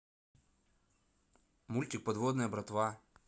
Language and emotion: Russian, neutral